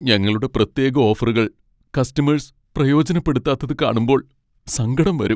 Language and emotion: Malayalam, sad